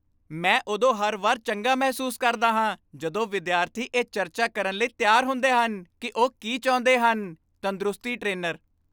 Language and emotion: Punjabi, happy